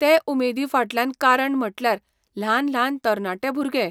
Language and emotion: Goan Konkani, neutral